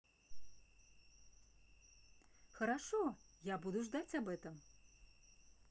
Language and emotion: Russian, positive